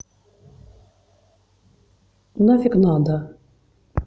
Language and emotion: Russian, neutral